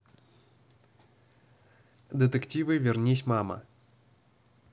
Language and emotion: Russian, neutral